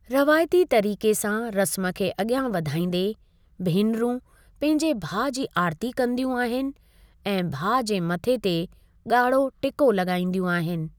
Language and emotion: Sindhi, neutral